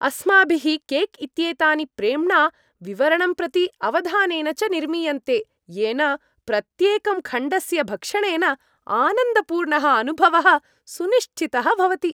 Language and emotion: Sanskrit, happy